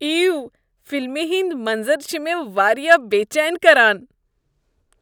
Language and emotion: Kashmiri, disgusted